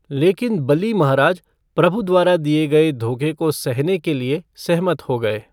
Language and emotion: Hindi, neutral